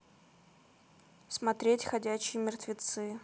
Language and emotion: Russian, neutral